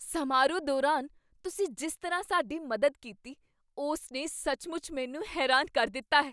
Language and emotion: Punjabi, surprised